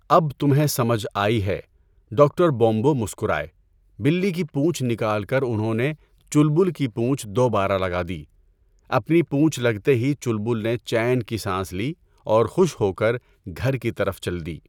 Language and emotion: Urdu, neutral